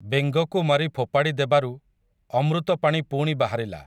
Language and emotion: Odia, neutral